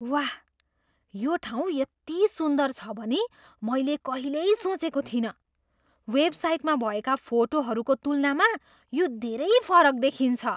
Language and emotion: Nepali, surprised